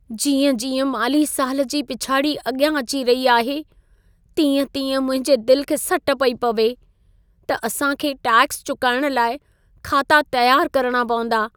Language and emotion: Sindhi, sad